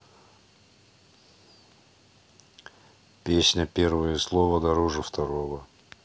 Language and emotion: Russian, neutral